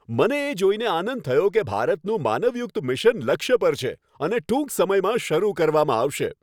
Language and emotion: Gujarati, happy